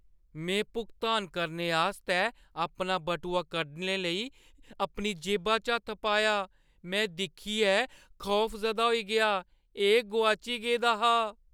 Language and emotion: Dogri, fearful